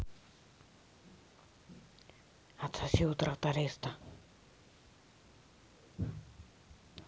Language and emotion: Russian, neutral